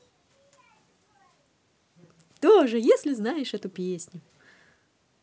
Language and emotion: Russian, positive